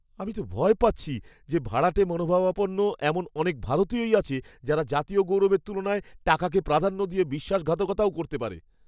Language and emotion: Bengali, fearful